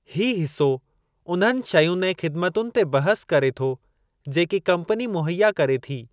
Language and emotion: Sindhi, neutral